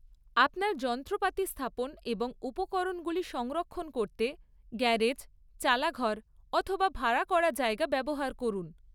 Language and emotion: Bengali, neutral